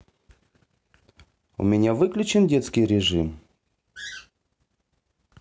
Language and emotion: Russian, neutral